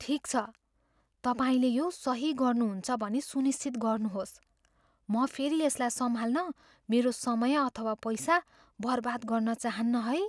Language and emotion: Nepali, fearful